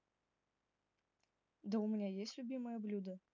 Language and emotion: Russian, neutral